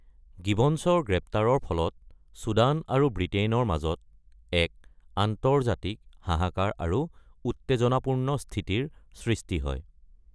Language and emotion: Assamese, neutral